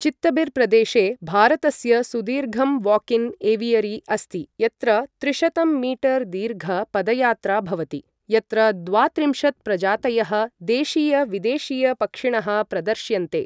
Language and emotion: Sanskrit, neutral